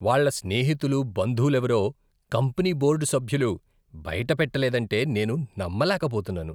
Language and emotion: Telugu, disgusted